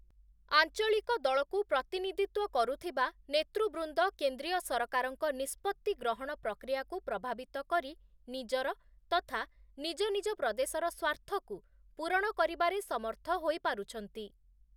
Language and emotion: Odia, neutral